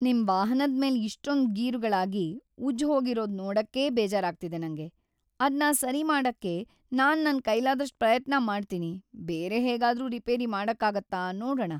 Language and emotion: Kannada, sad